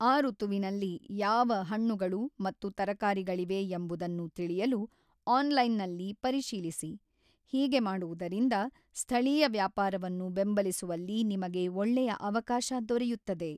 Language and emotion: Kannada, neutral